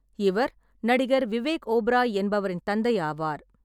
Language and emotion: Tamil, neutral